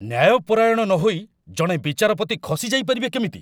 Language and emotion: Odia, angry